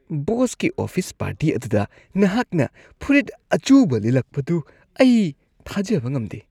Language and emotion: Manipuri, disgusted